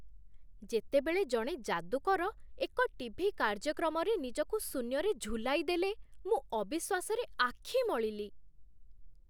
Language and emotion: Odia, surprised